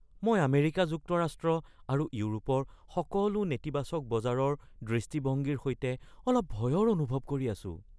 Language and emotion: Assamese, fearful